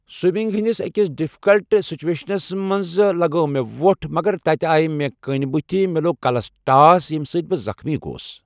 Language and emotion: Kashmiri, neutral